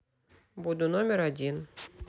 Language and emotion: Russian, neutral